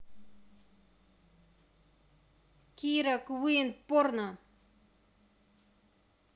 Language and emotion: Russian, neutral